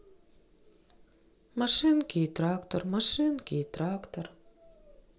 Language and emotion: Russian, sad